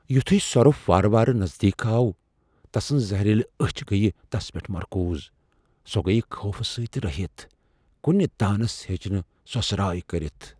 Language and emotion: Kashmiri, fearful